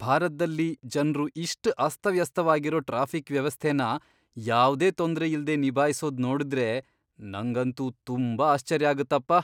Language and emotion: Kannada, surprised